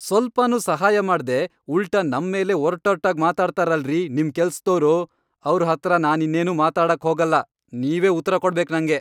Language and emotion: Kannada, angry